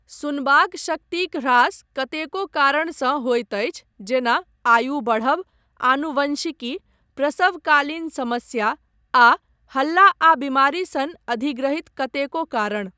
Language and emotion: Maithili, neutral